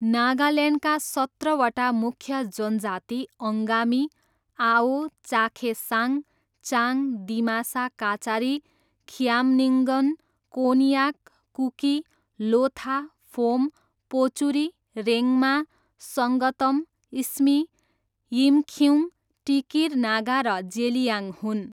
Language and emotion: Nepali, neutral